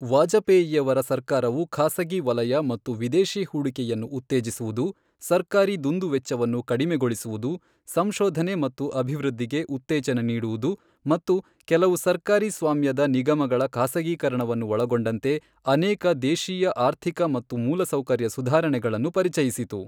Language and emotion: Kannada, neutral